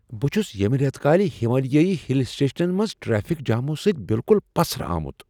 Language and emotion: Kashmiri, surprised